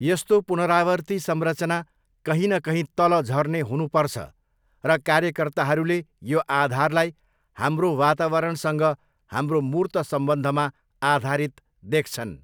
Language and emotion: Nepali, neutral